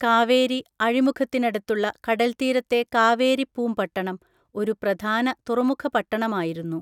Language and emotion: Malayalam, neutral